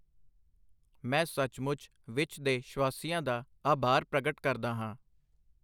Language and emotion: Punjabi, neutral